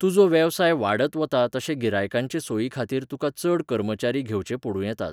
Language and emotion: Goan Konkani, neutral